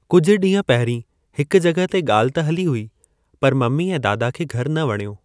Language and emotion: Sindhi, neutral